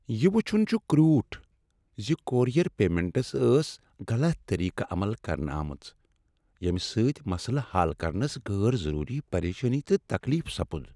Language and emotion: Kashmiri, sad